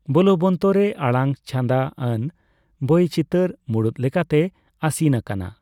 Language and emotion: Santali, neutral